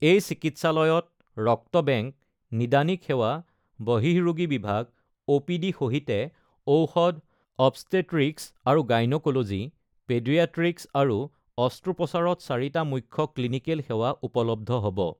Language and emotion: Assamese, neutral